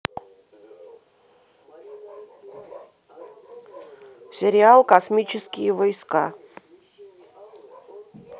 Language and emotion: Russian, neutral